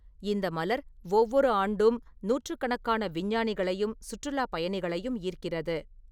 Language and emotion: Tamil, neutral